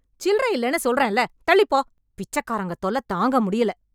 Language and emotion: Tamil, angry